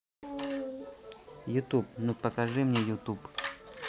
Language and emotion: Russian, neutral